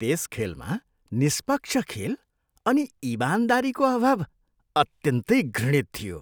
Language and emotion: Nepali, disgusted